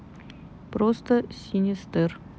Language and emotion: Russian, neutral